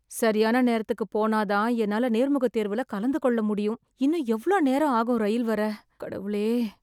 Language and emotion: Tamil, sad